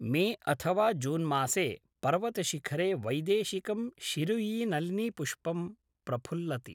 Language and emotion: Sanskrit, neutral